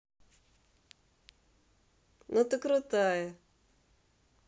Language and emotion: Russian, positive